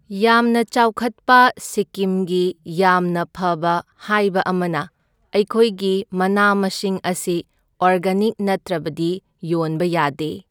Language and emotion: Manipuri, neutral